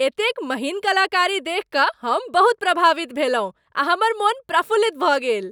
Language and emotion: Maithili, happy